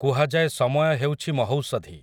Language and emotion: Odia, neutral